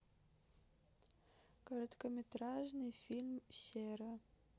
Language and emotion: Russian, neutral